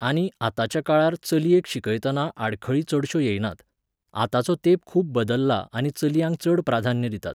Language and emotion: Goan Konkani, neutral